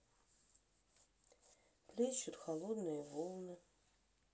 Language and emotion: Russian, sad